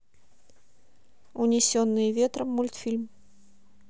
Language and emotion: Russian, neutral